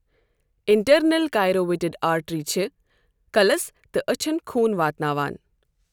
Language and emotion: Kashmiri, neutral